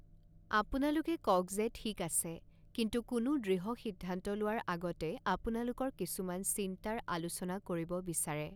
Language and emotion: Assamese, neutral